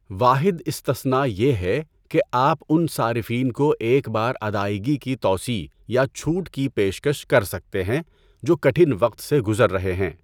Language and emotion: Urdu, neutral